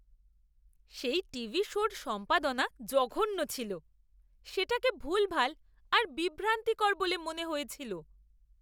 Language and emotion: Bengali, disgusted